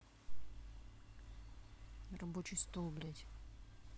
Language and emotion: Russian, angry